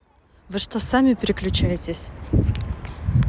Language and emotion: Russian, angry